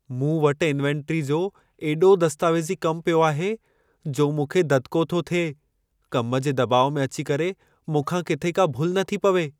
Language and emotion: Sindhi, fearful